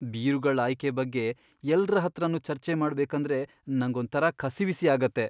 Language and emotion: Kannada, fearful